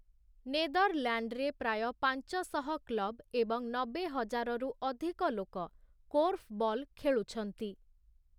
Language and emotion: Odia, neutral